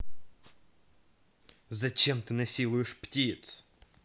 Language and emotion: Russian, angry